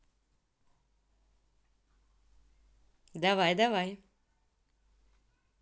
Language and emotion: Russian, positive